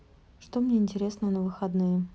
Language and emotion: Russian, neutral